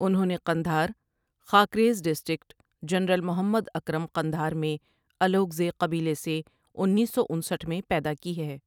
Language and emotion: Urdu, neutral